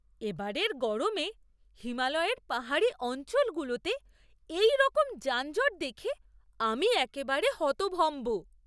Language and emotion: Bengali, surprised